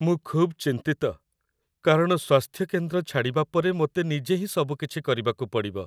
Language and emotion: Odia, sad